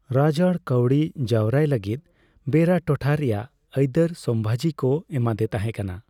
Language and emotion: Santali, neutral